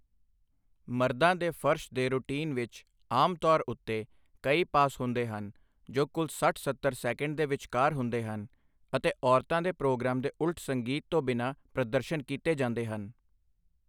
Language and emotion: Punjabi, neutral